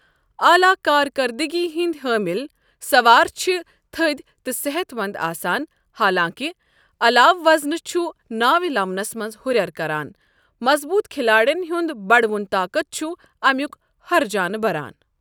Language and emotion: Kashmiri, neutral